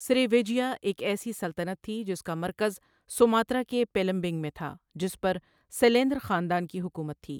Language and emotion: Urdu, neutral